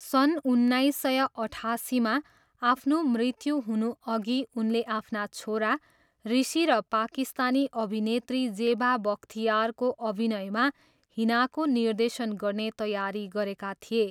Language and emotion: Nepali, neutral